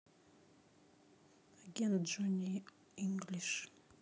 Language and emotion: Russian, neutral